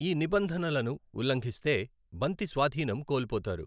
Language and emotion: Telugu, neutral